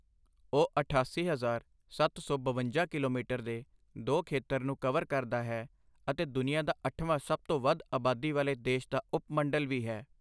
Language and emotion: Punjabi, neutral